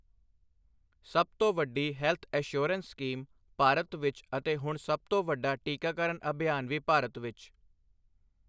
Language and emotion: Punjabi, neutral